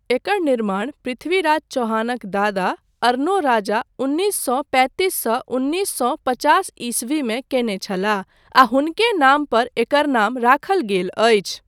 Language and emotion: Maithili, neutral